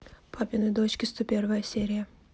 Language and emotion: Russian, neutral